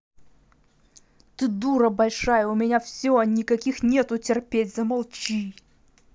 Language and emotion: Russian, angry